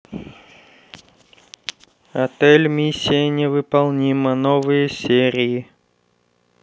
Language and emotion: Russian, neutral